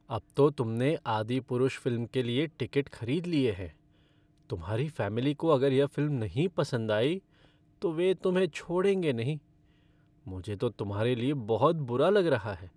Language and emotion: Hindi, sad